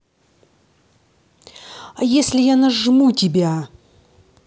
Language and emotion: Russian, angry